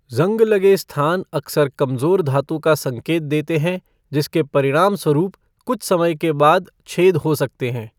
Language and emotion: Hindi, neutral